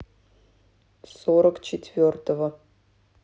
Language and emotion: Russian, neutral